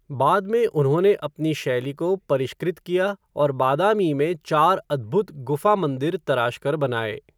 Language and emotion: Hindi, neutral